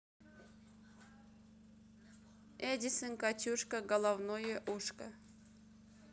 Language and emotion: Russian, neutral